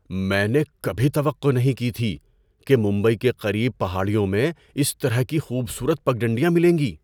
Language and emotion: Urdu, surprised